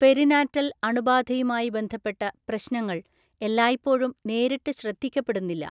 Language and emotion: Malayalam, neutral